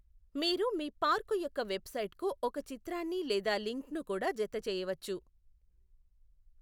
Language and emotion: Telugu, neutral